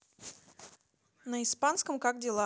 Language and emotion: Russian, neutral